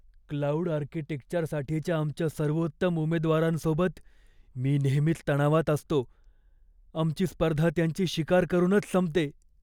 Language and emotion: Marathi, fearful